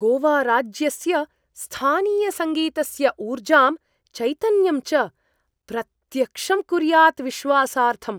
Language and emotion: Sanskrit, surprised